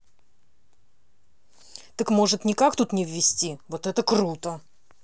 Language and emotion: Russian, angry